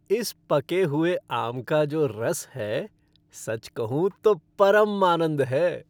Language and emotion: Hindi, happy